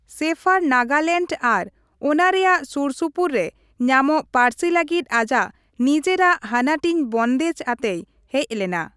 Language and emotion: Santali, neutral